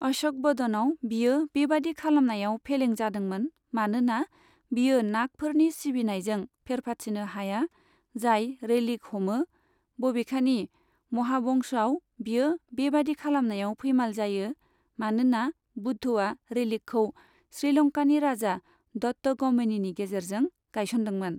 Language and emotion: Bodo, neutral